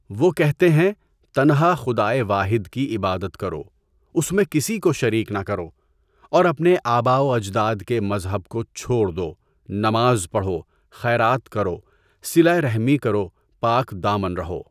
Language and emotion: Urdu, neutral